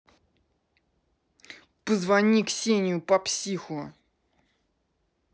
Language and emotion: Russian, angry